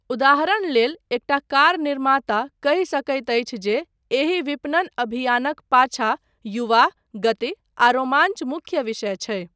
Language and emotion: Maithili, neutral